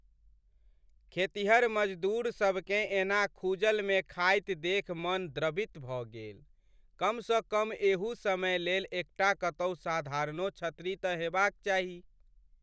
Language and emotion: Maithili, sad